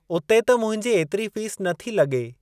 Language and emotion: Sindhi, neutral